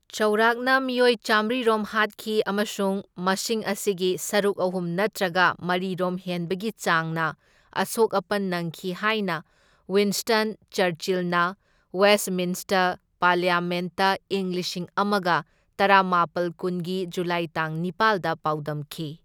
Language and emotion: Manipuri, neutral